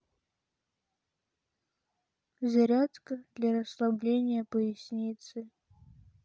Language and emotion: Russian, sad